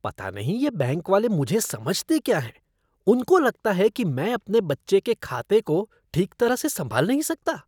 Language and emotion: Hindi, disgusted